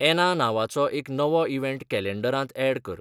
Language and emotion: Goan Konkani, neutral